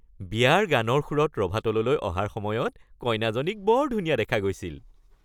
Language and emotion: Assamese, happy